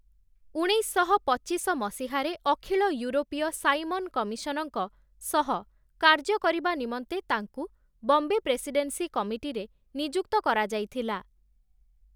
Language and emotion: Odia, neutral